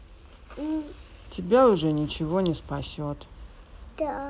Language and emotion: Russian, sad